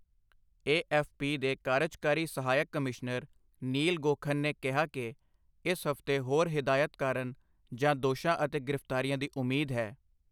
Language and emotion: Punjabi, neutral